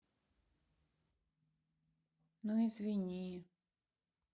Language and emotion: Russian, sad